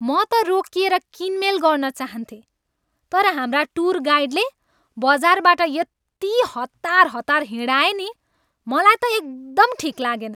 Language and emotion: Nepali, angry